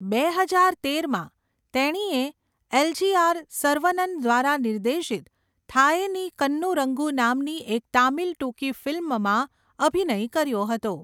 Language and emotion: Gujarati, neutral